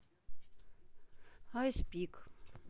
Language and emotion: Russian, sad